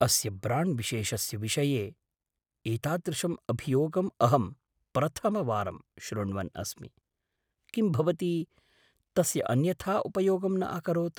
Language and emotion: Sanskrit, surprised